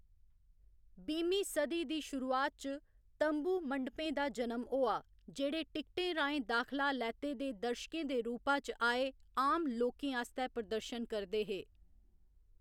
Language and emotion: Dogri, neutral